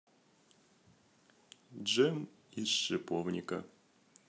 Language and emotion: Russian, neutral